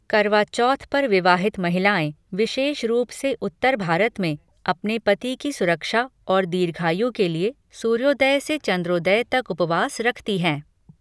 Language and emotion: Hindi, neutral